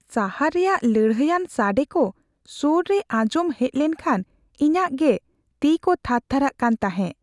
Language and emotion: Santali, fearful